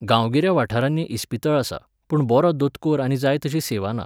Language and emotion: Goan Konkani, neutral